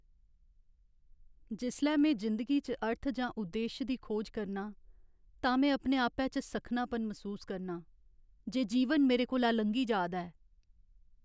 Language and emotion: Dogri, sad